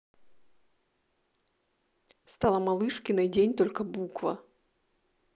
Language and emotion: Russian, neutral